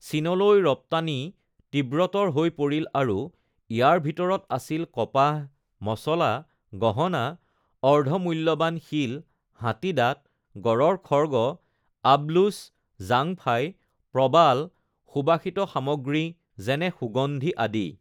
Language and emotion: Assamese, neutral